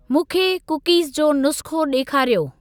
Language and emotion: Sindhi, neutral